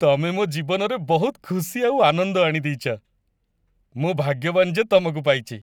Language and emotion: Odia, happy